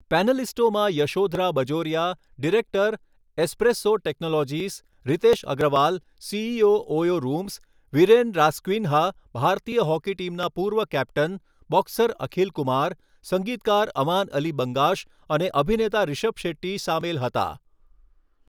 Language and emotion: Gujarati, neutral